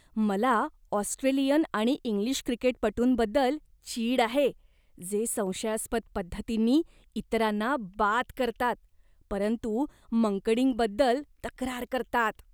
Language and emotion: Marathi, disgusted